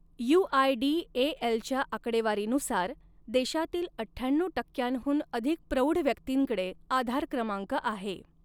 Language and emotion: Marathi, neutral